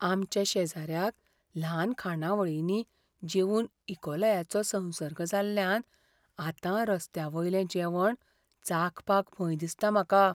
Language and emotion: Goan Konkani, fearful